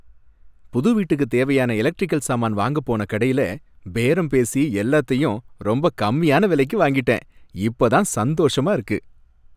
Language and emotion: Tamil, happy